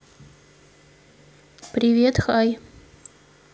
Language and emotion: Russian, neutral